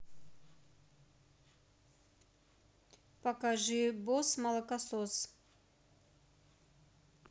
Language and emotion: Russian, neutral